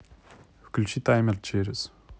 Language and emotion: Russian, neutral